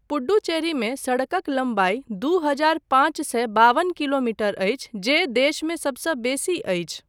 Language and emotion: Maithili, neutral